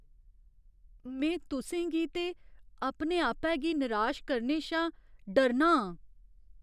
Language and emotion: Dogri, fearful